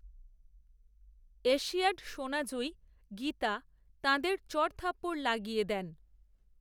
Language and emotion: Bengali, neutral